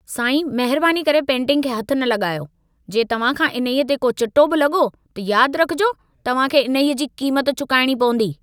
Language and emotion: Sindhi, angry